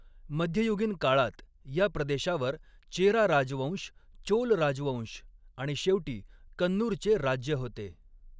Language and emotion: Marathi, neutral